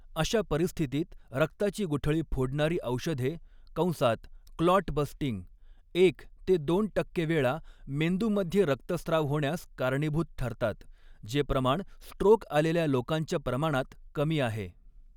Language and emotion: Marathi, neutral